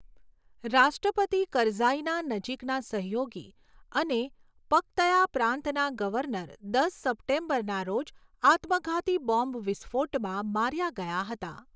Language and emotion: Gujarati, neutral